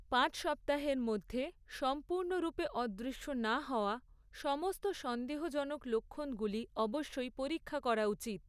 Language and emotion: Bengali, neutral